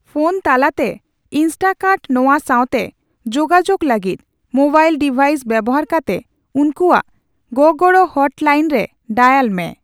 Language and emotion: Santali, neutral